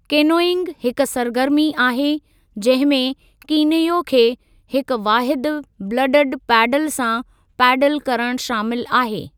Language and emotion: Sindhi, neutral